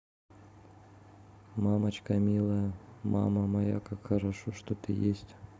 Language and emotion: Russian, sad